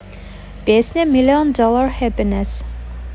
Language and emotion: Russian, neutral